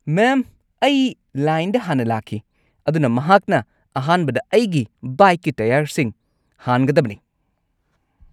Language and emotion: Manipuri, angry